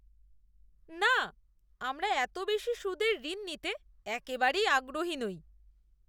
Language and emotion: Bengali, disgusted